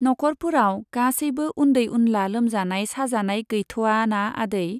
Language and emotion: Bodo, neutral